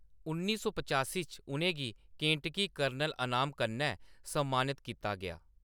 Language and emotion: Dogri, neutral